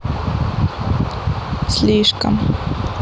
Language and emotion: Russian, neutral